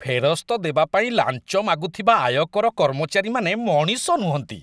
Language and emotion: Odia, disgusted